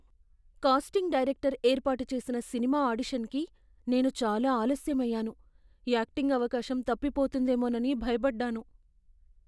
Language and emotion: Telugu, fearful